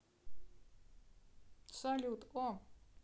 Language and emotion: Russian, neutral